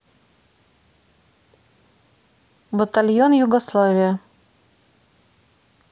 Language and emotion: Russian, neutral